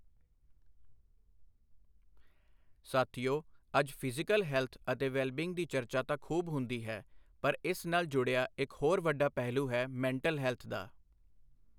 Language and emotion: Punjabi, neutral